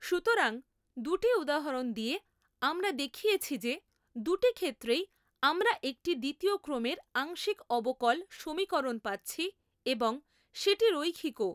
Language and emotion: Bengali, neutral